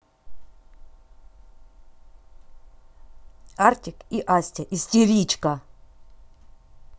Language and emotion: Russian, angry